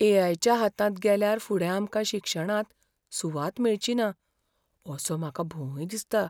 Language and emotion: Goan Konkani, fearful